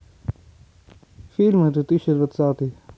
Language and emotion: Russian, neutral